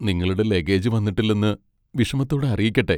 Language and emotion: Malayalam, sad